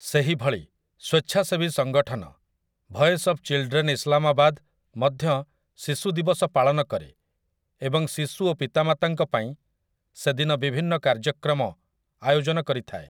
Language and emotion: Odia, neutral